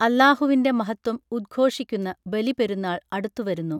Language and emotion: Malayalam, neutral